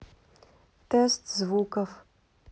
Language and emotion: Russian, neutral